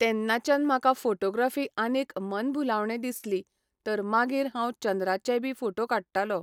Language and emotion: Goan Konkani, neutral